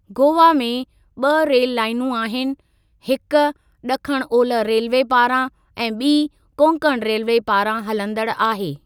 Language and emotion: Sindhi, neutral